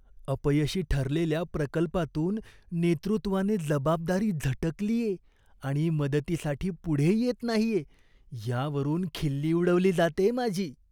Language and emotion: Marathi, disgusted